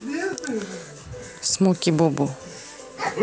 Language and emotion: Russian, neutral